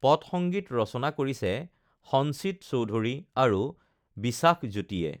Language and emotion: Assamese, neutral